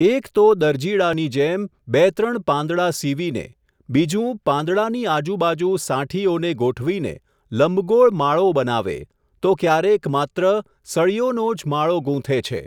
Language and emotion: Gujarati, neutral